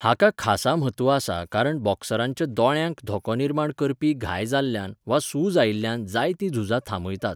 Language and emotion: Goan Konkani, neutral